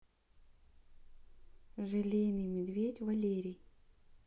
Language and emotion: Russian, neutral